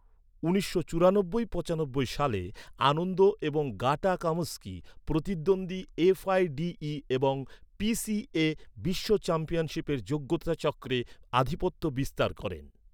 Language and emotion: Bengali, neutral